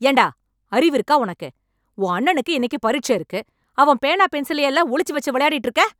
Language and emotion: Tamil, angry